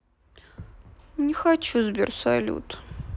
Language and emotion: Russian, sad